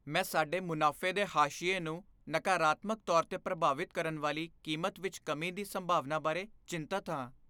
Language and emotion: Punjabi, fearful